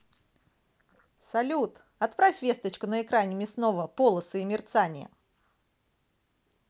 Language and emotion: Russian, positive